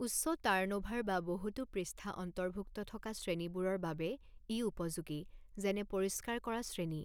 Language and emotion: Assamese, neutral